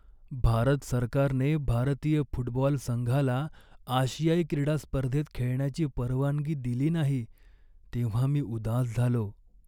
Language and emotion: Marathi, sad